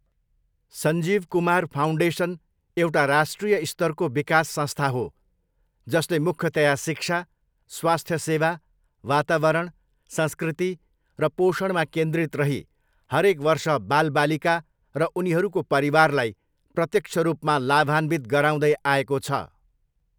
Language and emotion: Nepali, neutral